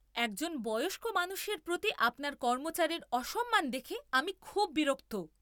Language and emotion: Bengali, angry